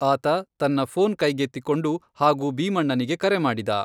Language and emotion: Kannada, neutral